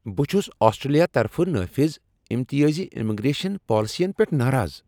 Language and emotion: Kashmiri, angry